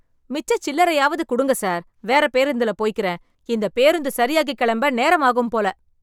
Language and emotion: Tamil, angry